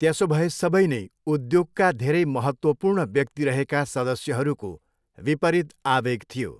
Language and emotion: Nepali, neutral